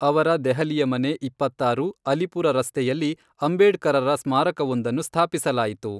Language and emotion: Kannada, neutral